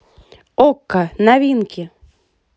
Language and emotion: Russian, positive